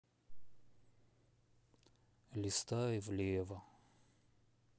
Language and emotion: Russian, sad